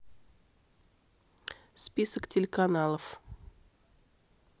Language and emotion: Russian, neutral